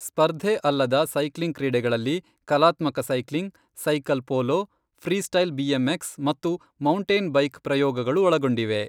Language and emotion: Kannada, neutral